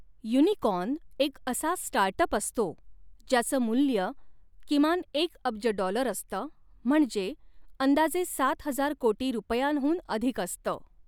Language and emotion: Marathi, neutral